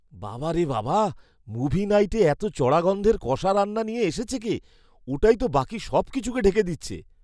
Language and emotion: Bengali, disgusted